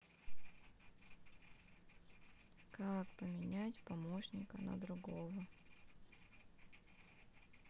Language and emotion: Russian, sad